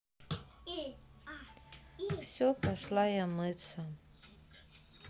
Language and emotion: Russian, sad